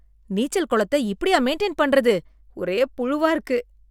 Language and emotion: Tamil, disgusted